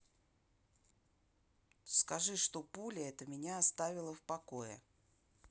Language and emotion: Russian, angry